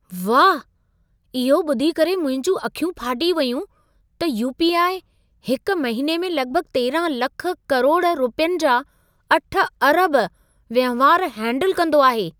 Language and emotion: Sindhi, surprised